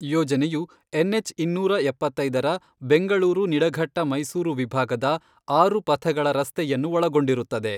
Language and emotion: Kannada, neutral